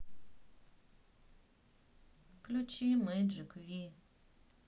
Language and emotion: Russian, sad